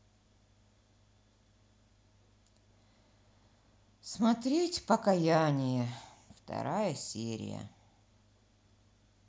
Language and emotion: Russian, sad